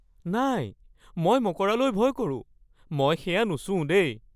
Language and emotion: Assamese, fearful